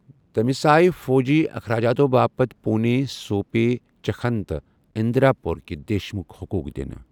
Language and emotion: Kashmiri, neutral